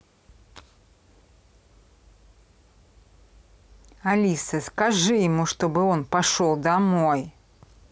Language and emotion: Russian, angry